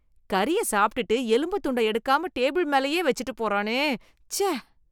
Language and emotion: Tamil, disgusted